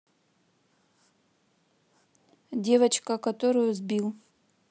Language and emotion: Russian, neutral